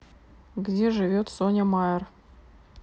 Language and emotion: Russian, neutral